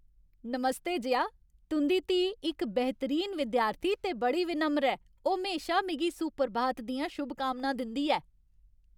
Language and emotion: Dogri, happy